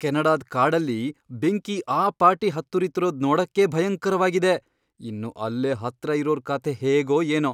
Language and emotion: Kannada, fearful